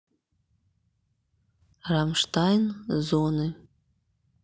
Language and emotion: Russian, neutral